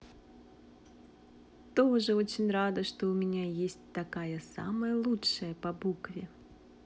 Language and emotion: Russian, positive